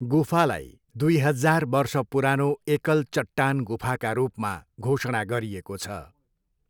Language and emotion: Nepali, neutral